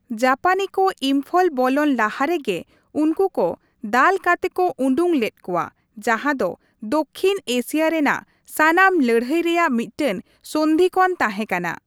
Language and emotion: Santali, neutral